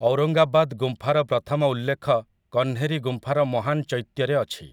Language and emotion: Odia, neutral